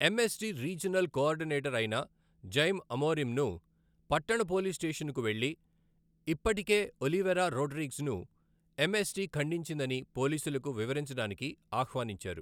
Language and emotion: Telugu, neutral